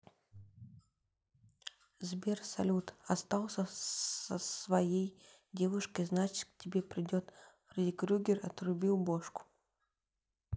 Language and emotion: Russian, neutral